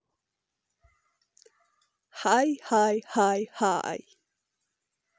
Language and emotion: Russian, positive